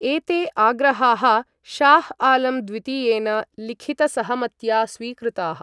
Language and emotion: Sanskrit, neutral